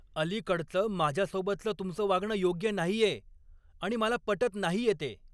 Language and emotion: Marathi, angry